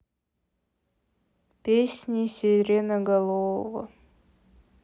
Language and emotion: Russian, sad